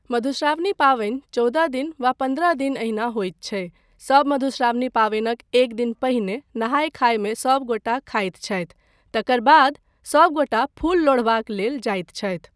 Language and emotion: Maithili, neutral